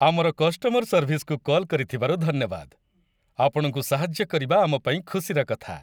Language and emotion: Odia, happy